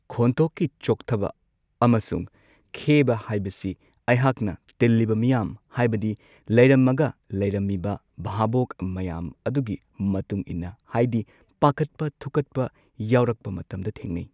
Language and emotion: Manipuri, neutral